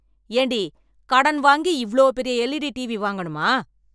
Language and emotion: Tamil, angry